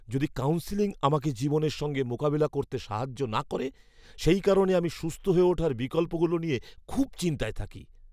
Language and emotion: Bengali, fearful